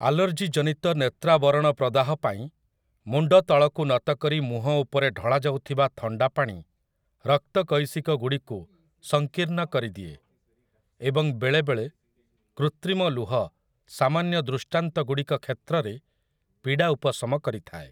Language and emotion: Odia, neutral